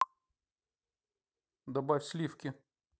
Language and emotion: Russian, neutral